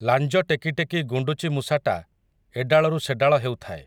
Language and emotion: Odia, neutral